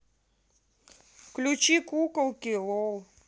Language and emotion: Russian, neutral